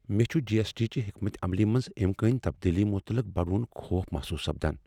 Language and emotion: Kashmiri, fearful